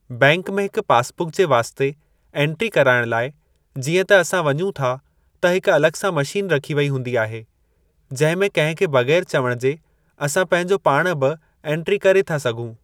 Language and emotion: Sindhi, neutral